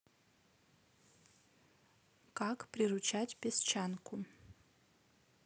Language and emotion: Russian, neutral